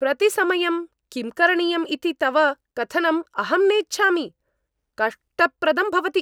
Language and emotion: Sanskrit, angry